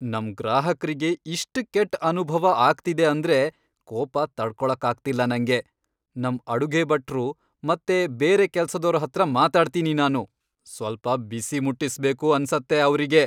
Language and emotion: Kannada, angry